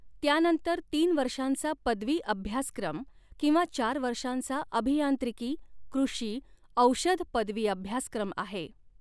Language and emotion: Marathi, neutral